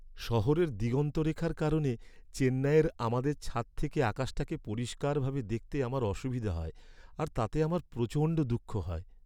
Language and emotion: Bengali, sad